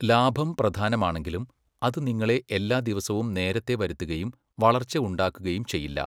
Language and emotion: Malayalam, neutral